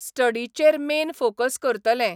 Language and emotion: Goan Konkani, neutral